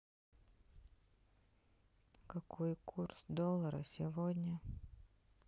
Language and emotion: Russian, sad